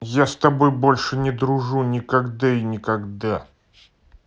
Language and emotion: Russian, angry